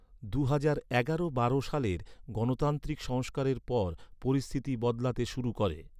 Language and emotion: Bengali, neutral